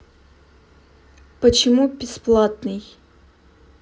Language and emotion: Russian, neutral